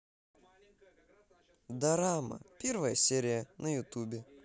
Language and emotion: Russian, positive